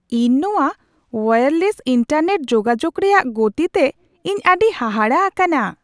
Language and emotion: Santali, surprised